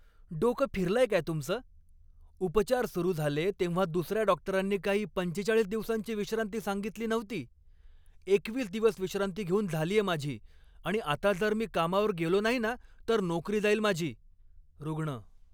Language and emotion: Marathi, angry